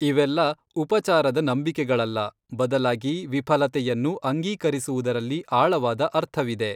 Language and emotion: Kannada, neutral